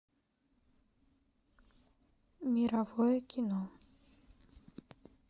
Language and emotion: Russian, sad